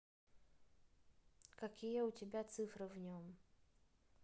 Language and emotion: Russian, neutral